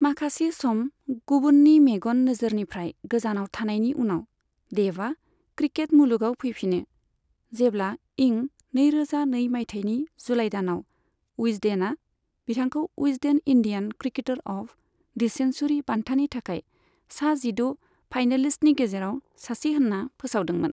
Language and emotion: Bodo, neutral